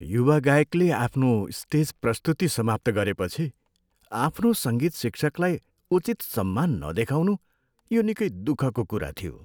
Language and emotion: Nepali, sad